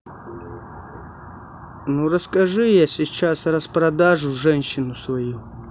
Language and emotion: Russian, neutral